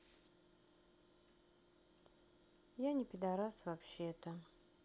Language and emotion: Russian, sad